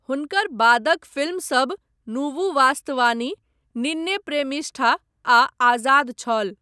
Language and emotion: Maithili, neutral